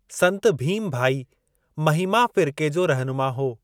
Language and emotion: Sindhi, neutral